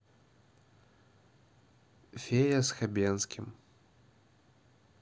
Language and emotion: Russian, neutral